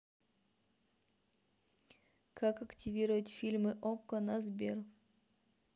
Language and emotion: Russian, neutral